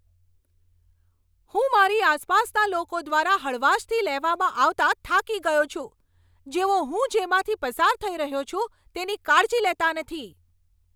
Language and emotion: Gujarati, angry